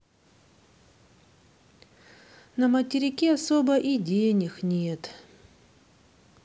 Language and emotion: Russian, sad